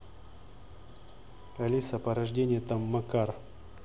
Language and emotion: Russian, neutral